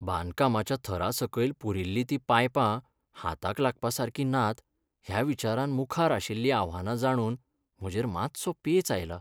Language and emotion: Goan Konkani, sad